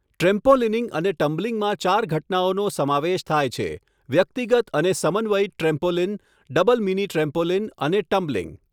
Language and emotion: Gujarati, neutral